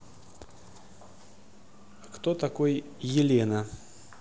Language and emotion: Russian, neutral